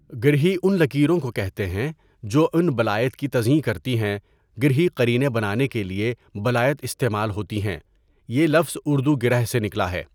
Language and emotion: Urdu, neutral